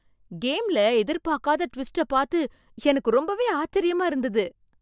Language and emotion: Tamil, surprised